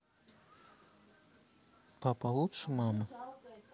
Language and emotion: Russian, neutral